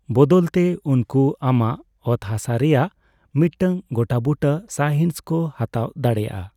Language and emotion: Santali, neutral